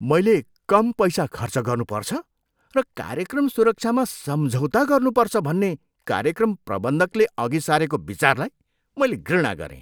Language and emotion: Nepali, disgusted